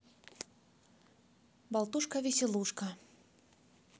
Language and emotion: Russian, positive